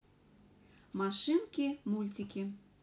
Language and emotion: Russian, positive